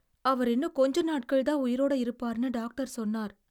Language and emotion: Tamil, sad